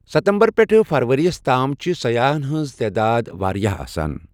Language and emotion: Kashmiri, neutral